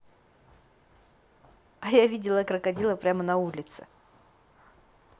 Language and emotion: Russian, positive